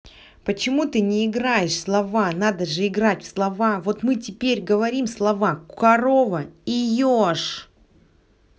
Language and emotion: Russian, angry